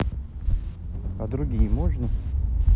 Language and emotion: Russian, neutral